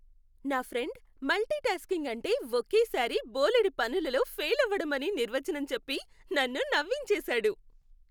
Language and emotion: Telugu, happy